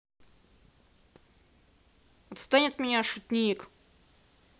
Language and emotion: Russian, angry